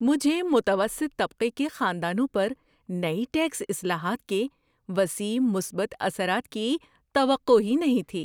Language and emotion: Urdu, surprised